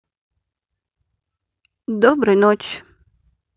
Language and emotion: Russian, neutral